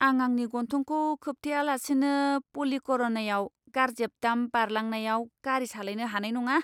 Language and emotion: Bodo, disgusted